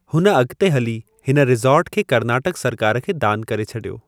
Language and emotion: Sindhi, neutral